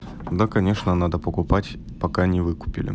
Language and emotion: Russian, neutral